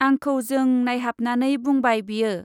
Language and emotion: Bodo, neutral